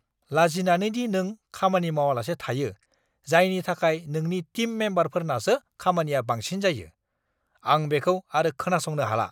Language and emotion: Bodo, angry